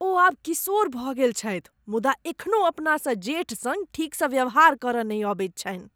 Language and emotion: Maithili, disgusted